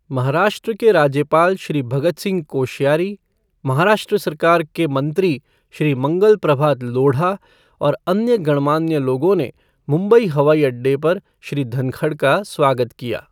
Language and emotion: Hindi, neutral